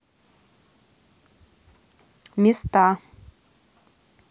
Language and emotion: Russian, neutral